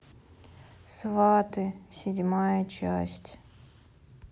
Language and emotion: Russian, sad